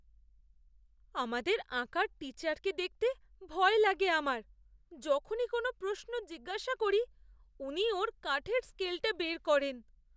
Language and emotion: Bengali, fearful